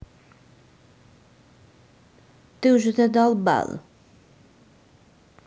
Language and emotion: Russian, angry